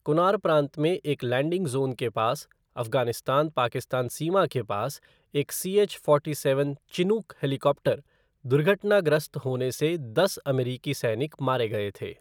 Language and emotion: Hindi, neutral